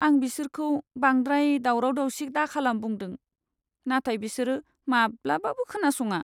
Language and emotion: Bodo, sad